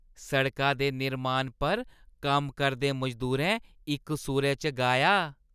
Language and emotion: Dogri, happy